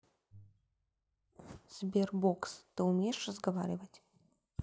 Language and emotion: Russian, neutral